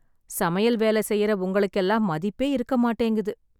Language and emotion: Tamil, sad